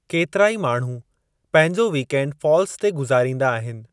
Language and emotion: Sindhi, neutral